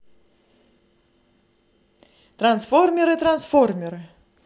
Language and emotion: Russian, positive